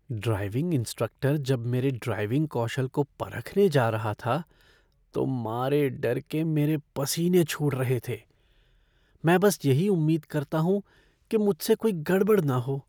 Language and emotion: Hindi, fearful